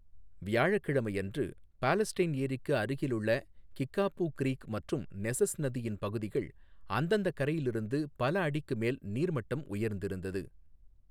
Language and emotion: Tamil, neutral